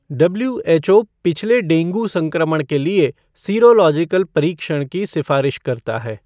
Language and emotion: Hindi, neutral